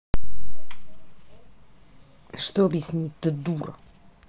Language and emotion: Russian, angry